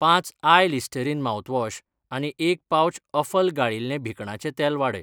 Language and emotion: Goan Konkani, neutral